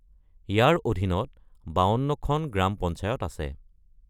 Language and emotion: Assamese, neutral